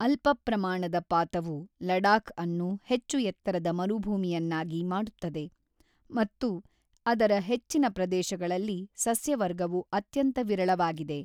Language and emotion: Kannada, neutral